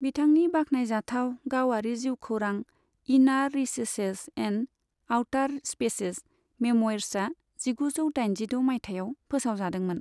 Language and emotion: Bodo, neutral